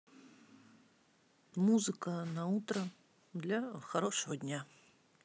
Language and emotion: Russian, neutral